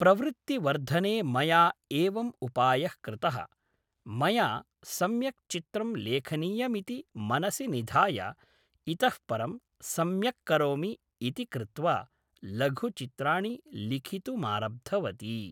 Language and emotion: Sanskrit, neutral